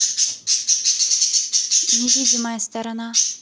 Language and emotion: Russian, neutral